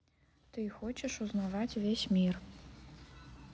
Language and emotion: Russian, neutral